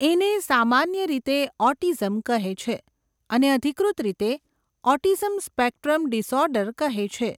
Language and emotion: Gujarati, neutral